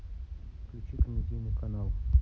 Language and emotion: Russian, neutral